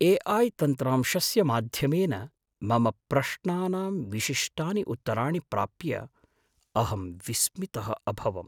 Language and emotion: Sanskrit, surprised